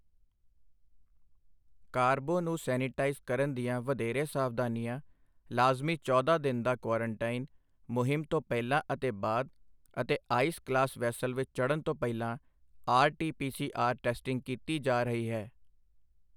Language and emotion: Punjabi, neutral